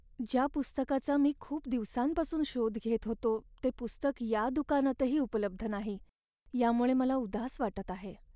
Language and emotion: Marathi, sad